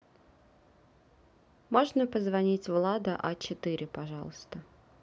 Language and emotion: Russian, neutral